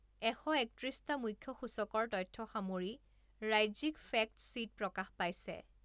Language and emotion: Assamese, neutral